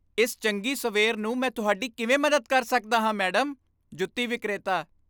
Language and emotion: Punjabi, happy